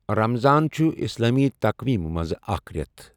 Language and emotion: Kashmiri, neutral